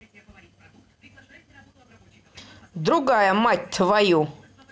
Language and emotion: Russian, angry